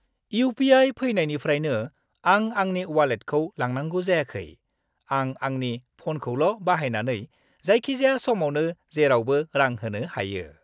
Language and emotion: Bodo, happy